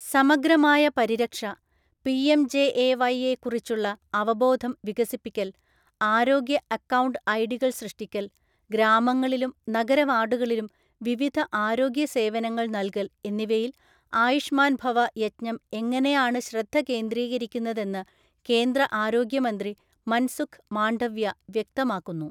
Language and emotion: Malayalam, neutral